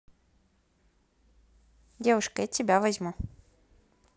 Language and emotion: Russian, neutral